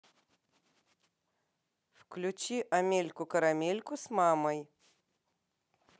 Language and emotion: Russian, positive